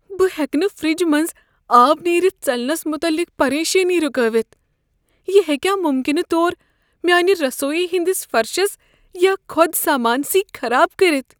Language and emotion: Kashmiri, fearful